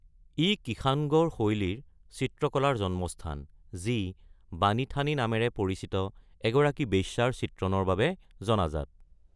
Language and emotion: Assamese, neutral